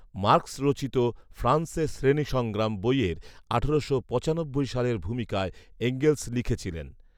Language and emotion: Bengali, neutral